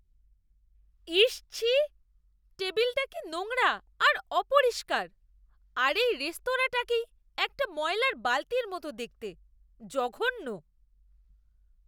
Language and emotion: Bengali, disgusted